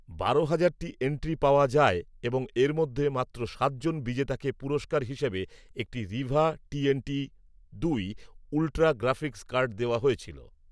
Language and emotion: Bengali, neutral